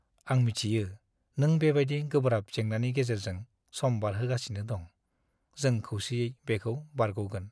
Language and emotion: Bodo, sad